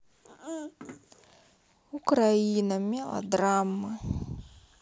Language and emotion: Russian, sad